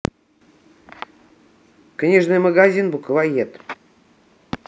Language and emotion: Russian, neutral